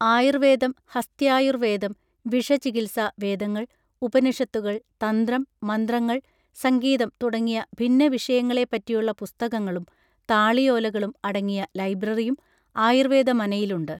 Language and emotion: Malayalam, neutral